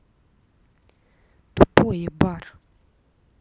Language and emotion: Russian, angry